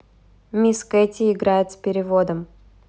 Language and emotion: Russian, neutral